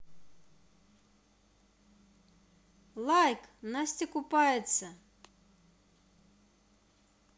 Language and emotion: Russian, positive